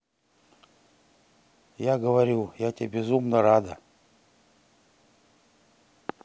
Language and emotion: Russian, neutral